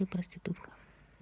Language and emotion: Russian, neutral